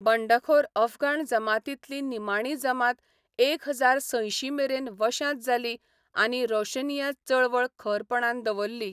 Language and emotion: Goan Konkani, neutral